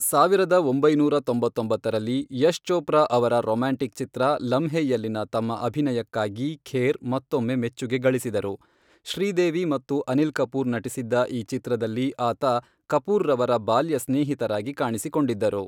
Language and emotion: Kannada, neutral